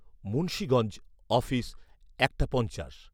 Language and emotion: Bengali, neutral